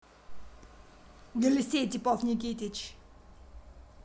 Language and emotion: Russian, angry